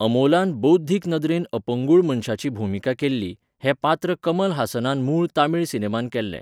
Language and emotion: Goan Konkani, neutral